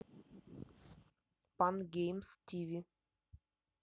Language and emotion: Russian, neutral